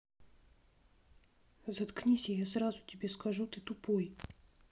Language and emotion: Russian, neutral